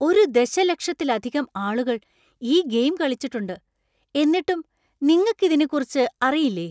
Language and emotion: Malayalam, surprised